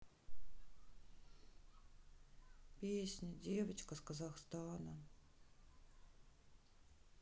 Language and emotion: Russian, sad